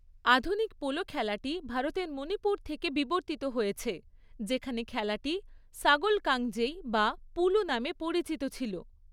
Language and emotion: Bengali, neutral